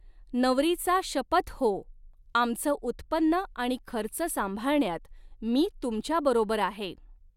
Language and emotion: Marathi, neutral